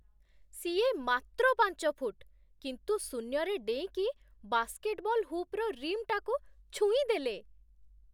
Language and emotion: Odia, surprised